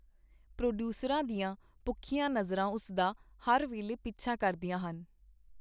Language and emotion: Punjabi, neutral